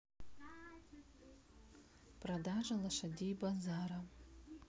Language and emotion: Russian, neutral